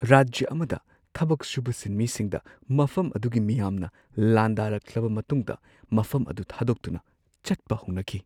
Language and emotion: Manipuri, fearful